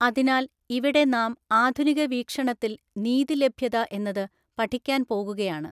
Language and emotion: Malayalam, neutral